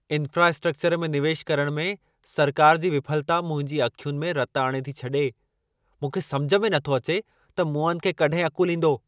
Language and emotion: Sindhi, angry